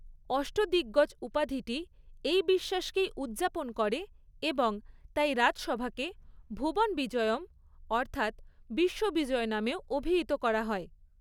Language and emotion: Bengali, neutral